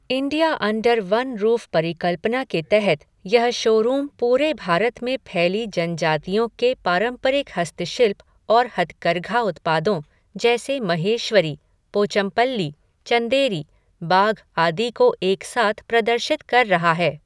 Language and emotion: Hindi, neutral